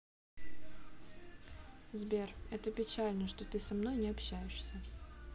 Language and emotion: Russian, sad